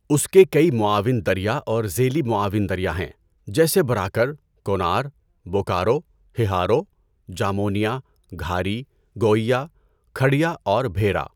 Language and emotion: Urdu, neutral